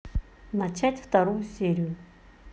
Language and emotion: Russian, neutral